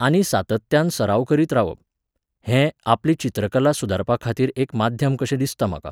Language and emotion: Goan Konkani, neutral